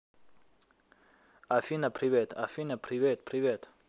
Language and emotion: Russian, neutral